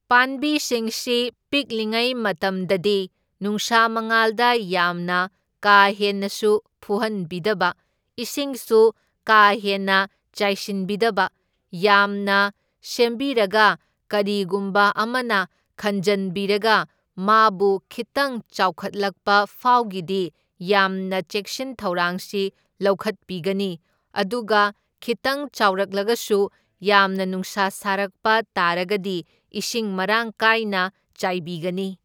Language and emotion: Manipuri, neutral